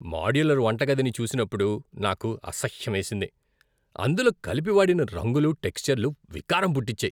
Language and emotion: Telugu, disgusted